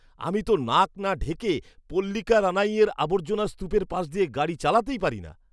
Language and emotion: Bengali, disgusted